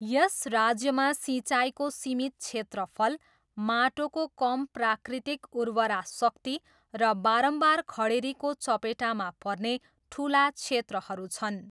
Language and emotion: Nepali, neutral